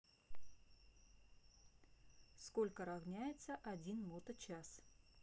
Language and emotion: Russian, neutral